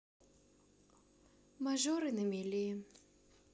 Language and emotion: Russian, sad